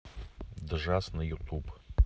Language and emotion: Russian, neutral